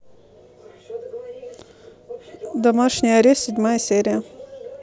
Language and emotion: Russian, neutral